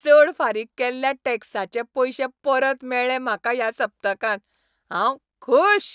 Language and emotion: Goan Konkani, happy